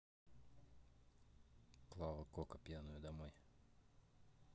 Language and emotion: Russian, neutral